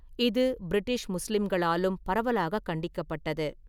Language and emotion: Tamil, neutral